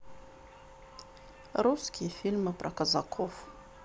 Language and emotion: Russian, sad